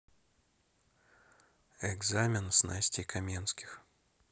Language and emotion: Russian, neutral